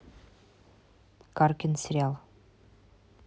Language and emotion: Russian, neutral